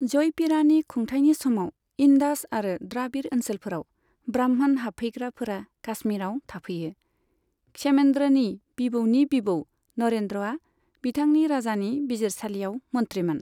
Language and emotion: Bodo, neutral